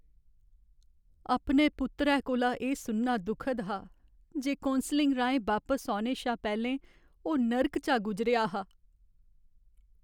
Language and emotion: Dogri, sad